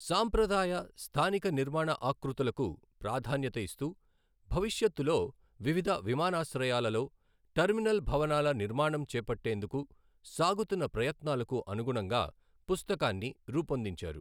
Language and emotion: Telugu, neutral